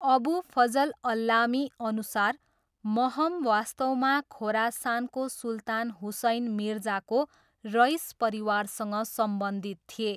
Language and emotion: Nepali, neutral